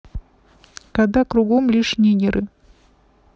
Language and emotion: Russian, neutral